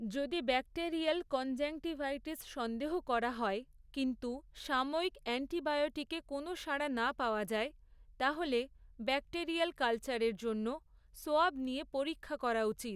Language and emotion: Bengali, neutral